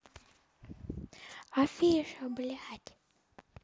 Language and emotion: Russian, neutral